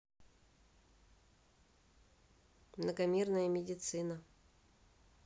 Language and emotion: Russian, neutral